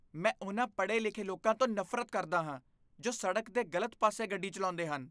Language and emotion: Punjabi, disgusted